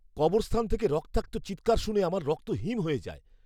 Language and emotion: Bengali, fearful